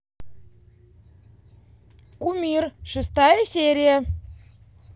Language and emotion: Russian, positive